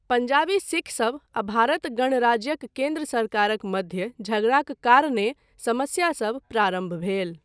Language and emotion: Maithili, neutral